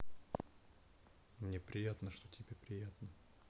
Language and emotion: Russian, neutral